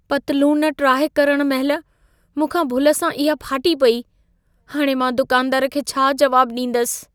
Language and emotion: Sindhi, fearful